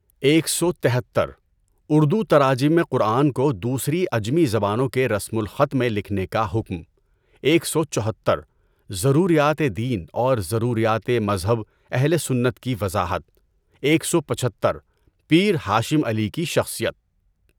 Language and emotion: Urdu, neutral